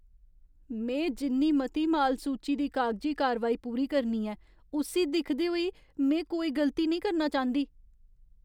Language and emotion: Dogri, fearful